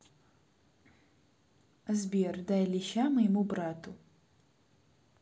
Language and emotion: Russian, neutral